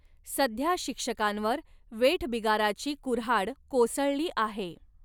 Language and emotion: Marathi, neutral